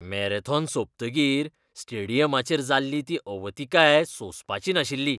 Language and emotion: Goan Konkani, disgusted